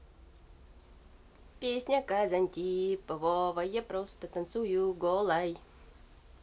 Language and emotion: Russian, positive